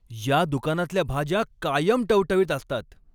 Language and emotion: Marathi, happy